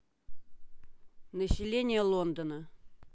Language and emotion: Russian, neutral